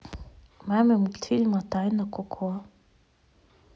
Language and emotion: Russian, neutral